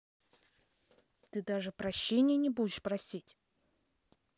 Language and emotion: Russian, angry